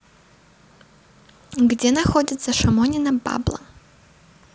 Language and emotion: Russian, neutral